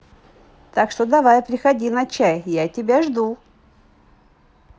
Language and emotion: Russian, positive